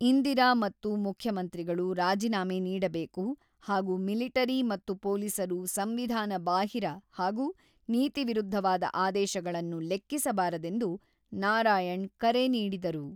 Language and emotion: Kannada, neutral